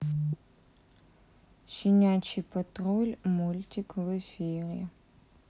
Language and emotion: Russian, sad